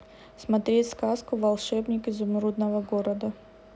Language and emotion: Russian, neutral